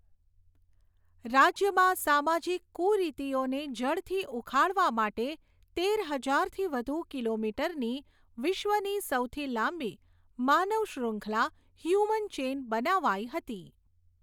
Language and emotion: Gujarati, neutral